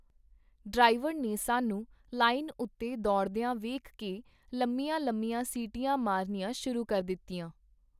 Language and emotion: Punjabi, neutral